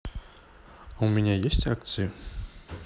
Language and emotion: Russian, neutral